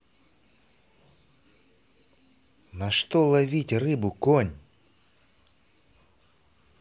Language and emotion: Russian, angry